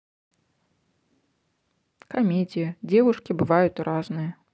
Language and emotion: Russian, neutral